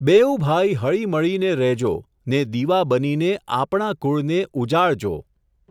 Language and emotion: Gujarati, neutral